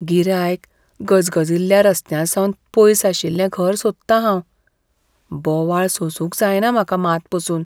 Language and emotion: Goan Konkani, fearful